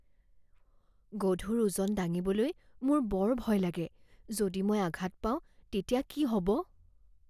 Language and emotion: Assamese, fearful